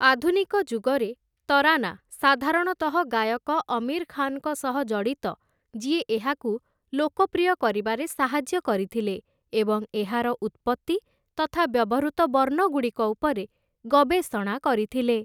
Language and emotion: Odia, neutral